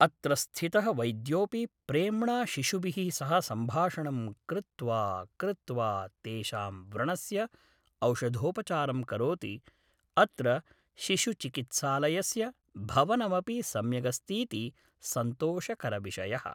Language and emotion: Sanskrit, neutral